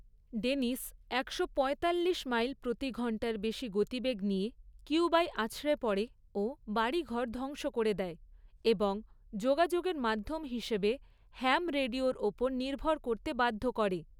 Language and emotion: Bengali, neutral